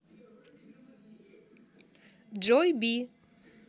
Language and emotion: Russian, positive